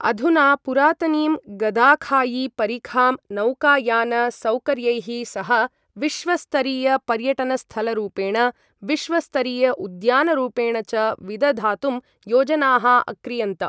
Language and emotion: Sanskrit, neutral